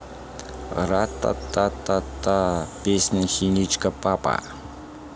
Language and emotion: Russian, positive